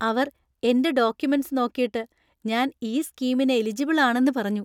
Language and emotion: Malayalam, happy